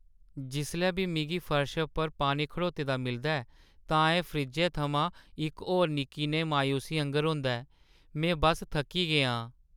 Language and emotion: Dogri, sad